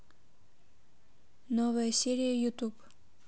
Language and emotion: Russian, neutral